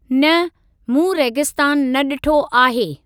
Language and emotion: Sindhi, neutral